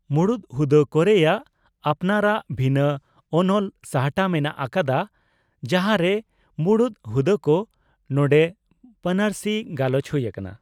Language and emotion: Santali, neutral